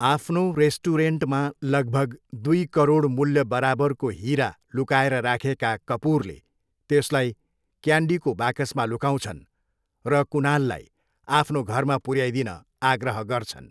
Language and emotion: Nepali, neutral